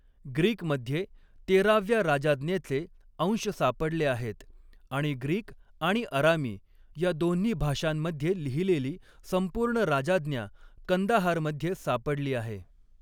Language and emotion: Marathi, neutral